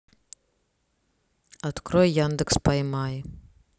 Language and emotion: Russian, neutral